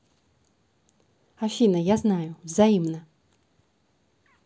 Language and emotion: Russian, neutral